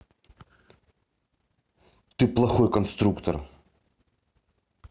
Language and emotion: Russian, angry